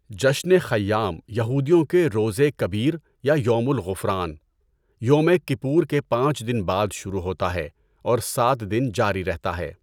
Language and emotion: Urdu, neutral